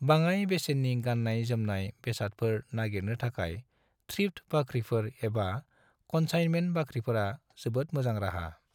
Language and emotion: Bodo, neutral